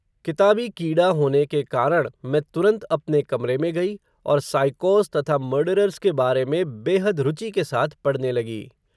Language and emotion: Hindi, neutral